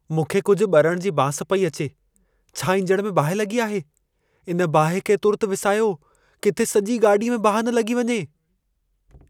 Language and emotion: Sindhi, fearful